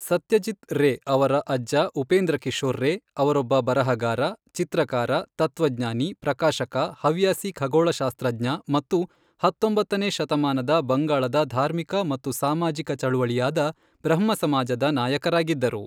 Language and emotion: Kannada, neutral